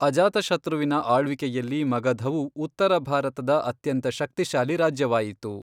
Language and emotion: Kannada, neutral